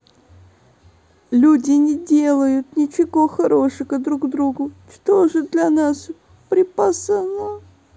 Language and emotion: Russian, sad